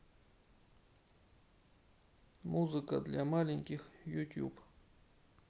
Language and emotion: Russian, neutral